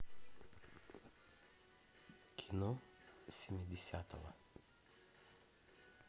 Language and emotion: Russian, neutral